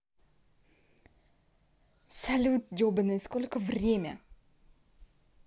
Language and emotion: Russian, angry